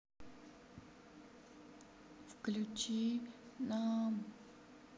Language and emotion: Russian, sad